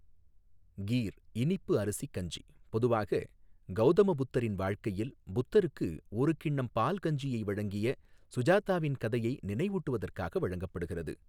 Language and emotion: Tamil, neutral